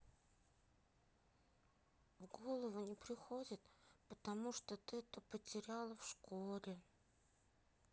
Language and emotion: Russian, sad